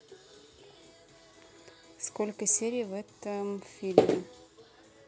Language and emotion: Russian, neutral